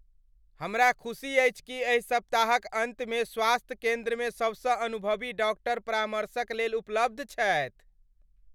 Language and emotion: Maithili, happy